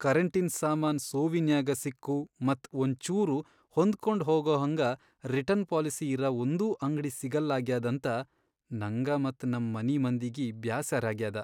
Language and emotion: Kannada, sad